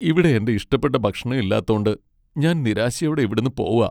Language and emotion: Malayalam, sad